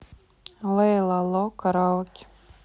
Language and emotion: Russian, neutral